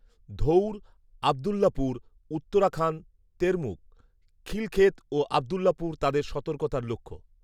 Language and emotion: Bengali, neutral